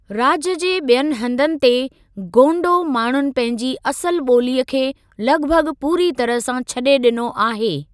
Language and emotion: Sindhi, neutral